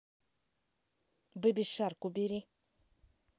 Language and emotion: Russian, neutral